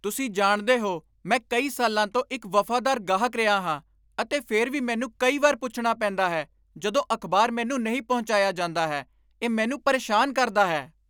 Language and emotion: Punjabi, angry